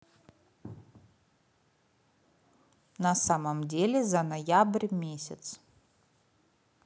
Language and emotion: Russian, neutral